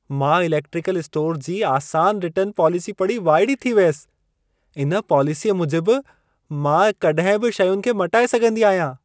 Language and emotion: Sindhi, surprised